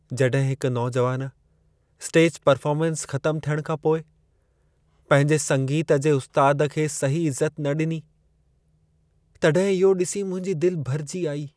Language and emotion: Sindhi, sad